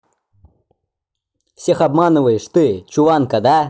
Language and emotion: Russian, angry